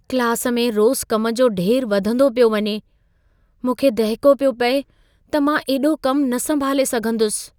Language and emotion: Sindhi, fearful